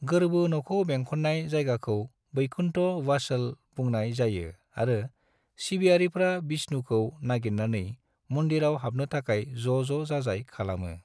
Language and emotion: Bodo, neutral